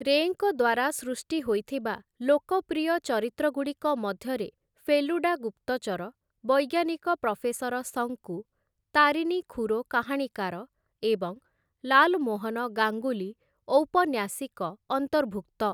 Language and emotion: Odia, neutral